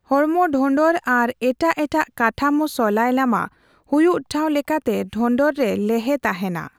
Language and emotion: Santali, neutral